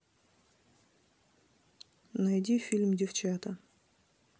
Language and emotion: Russian, neutral